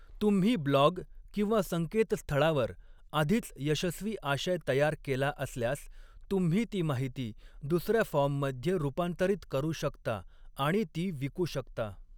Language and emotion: Marathi, neutral